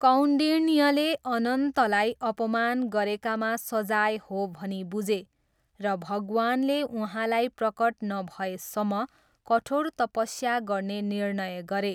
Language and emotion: Nepali, neutral